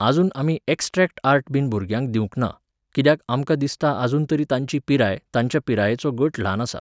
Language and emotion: Goan Konkani, neutral